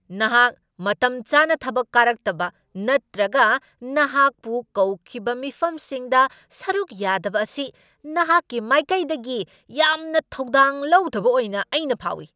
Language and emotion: Manipuri, angry